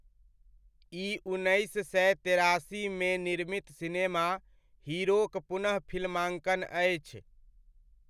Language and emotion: Maithili, neutral